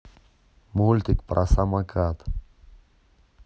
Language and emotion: Russian, neutral